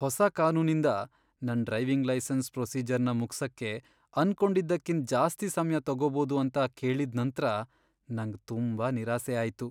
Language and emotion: Kannada, sad